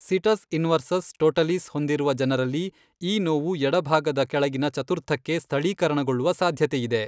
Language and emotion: Kannada, neutral